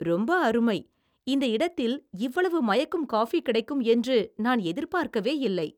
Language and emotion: Tamil, surprised